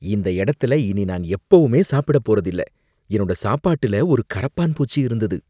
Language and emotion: Tamil, disgusted